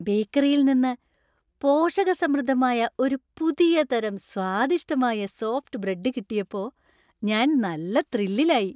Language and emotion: Malayalam, happy